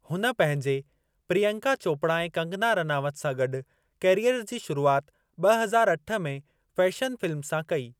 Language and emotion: Sindhi, neutral